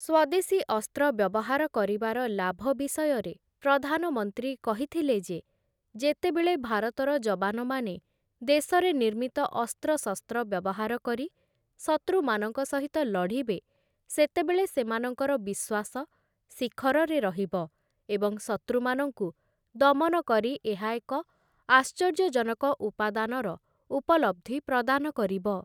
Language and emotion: Odia, neutral